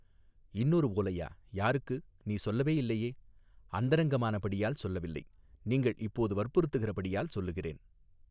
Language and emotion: Tamil, neutral